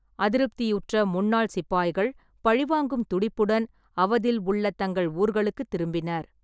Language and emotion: Tamil, neutral